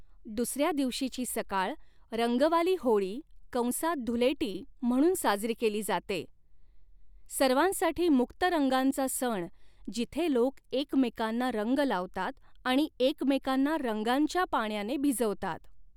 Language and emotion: Marathi, neutral